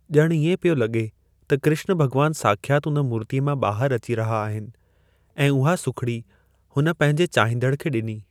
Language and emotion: Sindhi, neutral